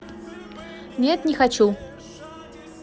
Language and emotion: Russian, neutral